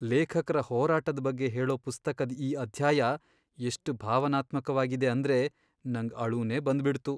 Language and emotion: Kannada, sad